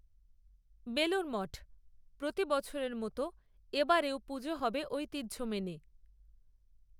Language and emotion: Bengali, neutral